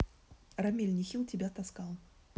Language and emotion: Russian, neutral